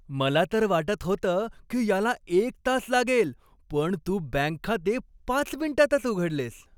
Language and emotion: Marathi, happy